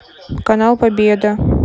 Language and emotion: Russian, neutral